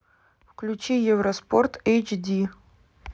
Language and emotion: Russian, neutral